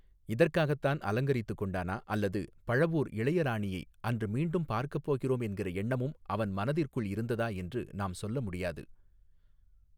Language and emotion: Tamil, neutral